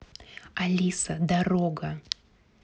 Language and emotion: Russian, neutral